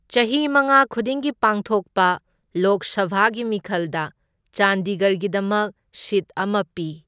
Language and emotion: Manipuri, neutral